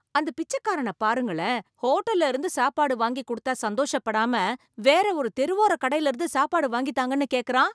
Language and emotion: Tamil, surprised